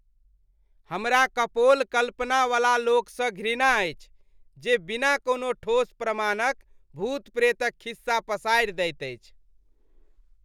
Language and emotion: Maithili, disgusted